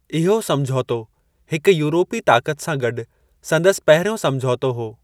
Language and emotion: Sindhi, neutral